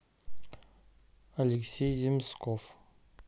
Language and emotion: Russian, neutral